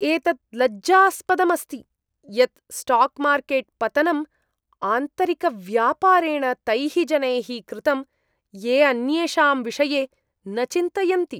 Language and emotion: Sanskrit, disgusted